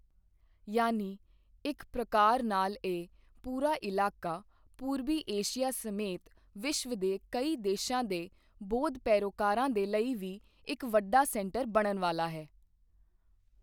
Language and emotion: Punjabi, neutral